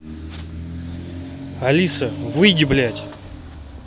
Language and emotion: Russian, angry